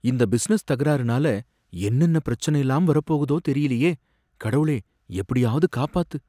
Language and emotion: Tamil, fearful